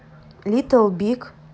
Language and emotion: Russian, neutral